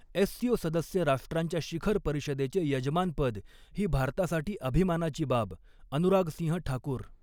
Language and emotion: Marathi, neutral